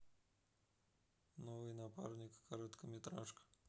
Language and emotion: Russian, neutral